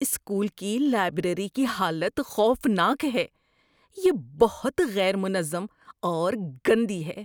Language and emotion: Urdu, disgusted